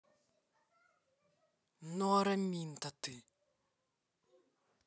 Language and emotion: Russian, neutral